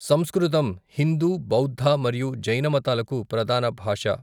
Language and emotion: Telugu, neutral